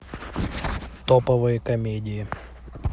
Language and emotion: Russian, neutral